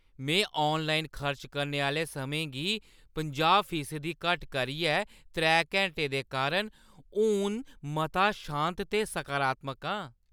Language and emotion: Dogri, happy